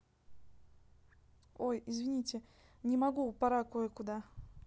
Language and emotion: Russian, neutral